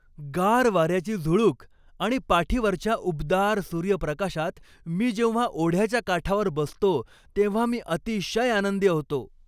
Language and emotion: Marathi, happy